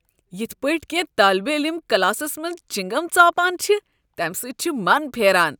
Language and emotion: Kashmiri, disgusted